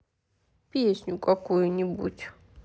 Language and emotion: Russian, sad